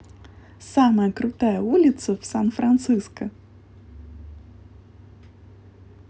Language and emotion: Russian, positive